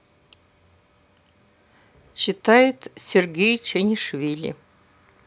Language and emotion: Russian, neutral